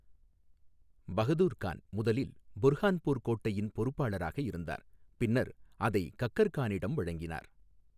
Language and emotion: Tamil, neutral